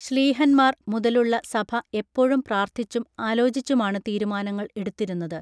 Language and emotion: Malayalam, neutral